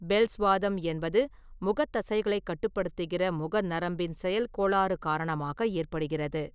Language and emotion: Tamil, neutral